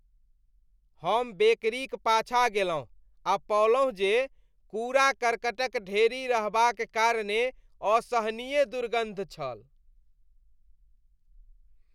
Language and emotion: Maithili, disgusted